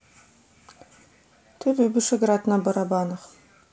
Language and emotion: Russian, neutral